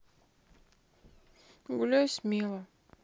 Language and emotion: Russian, sad